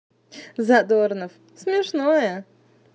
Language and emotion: Russian, positive